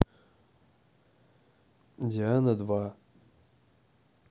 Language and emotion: Russian, neutral